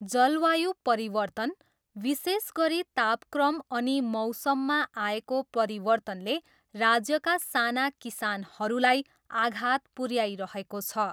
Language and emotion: Nepali, neutral